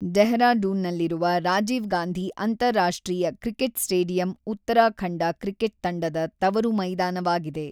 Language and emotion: Kannada, neutral